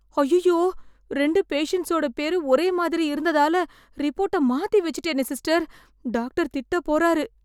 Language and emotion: Tamil, fearful